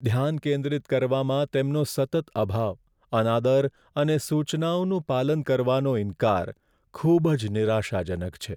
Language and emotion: Gujarati, sad